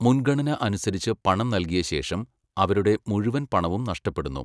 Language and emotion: Malayalam, neutral